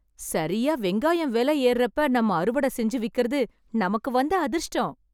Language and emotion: Tamil, happy